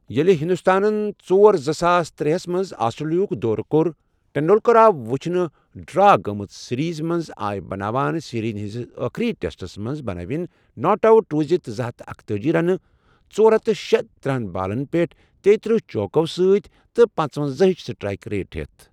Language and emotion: Kashmiri, neutral